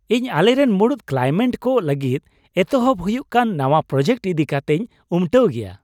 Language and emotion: Santali, happy